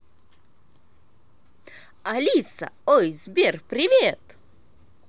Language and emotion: Russian, positive